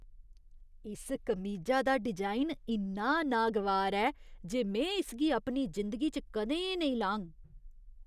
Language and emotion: Dogri, disgusted